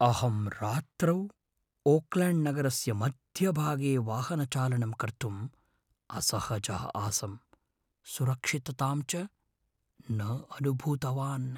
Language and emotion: Sanskrit, fearful